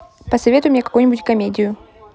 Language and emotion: Russian, neutral